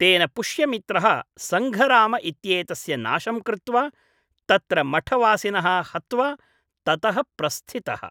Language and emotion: Sanskrit, neutral